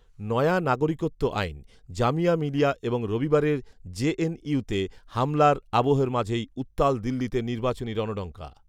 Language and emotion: Bengali, neutral